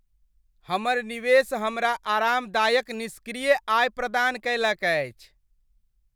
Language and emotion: Maithili, happy